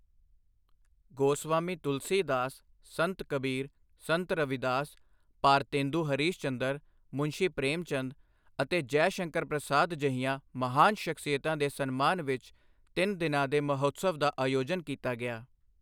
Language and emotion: Punjabi, neutral